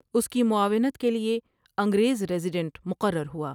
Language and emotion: Urdu, neutral